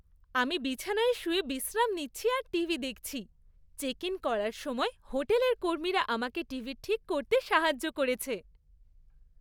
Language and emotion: Bengali, happy